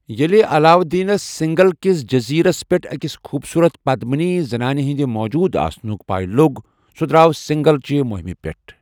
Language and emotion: Kashmiri, neutral